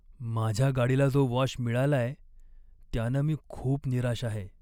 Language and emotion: Marathi, sad